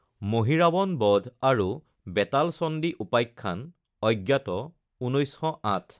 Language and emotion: Assamese, neutral